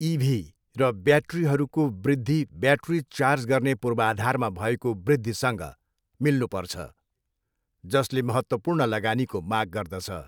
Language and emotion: Nepali, neutral